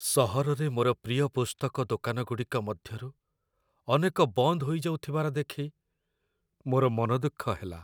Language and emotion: Odia, sad